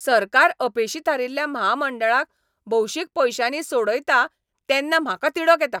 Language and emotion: Goan Konkani, angry